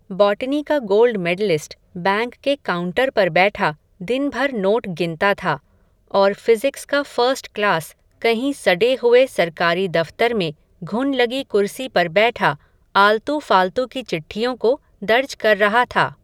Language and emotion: Hindi, neutral